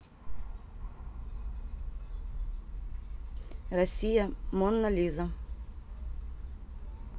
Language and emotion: Russian, neutral